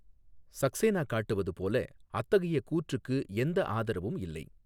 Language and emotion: Tamil, neutral